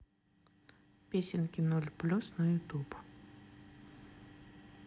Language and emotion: Russian, neutral